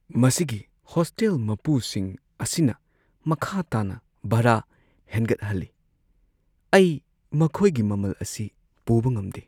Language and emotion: Manipuri, sad